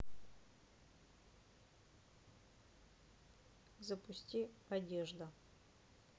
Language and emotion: Russian, neutral